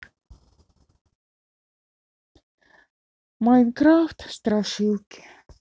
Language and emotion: Russian, sad